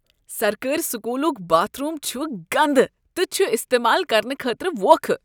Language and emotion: Kashmiri, disgusted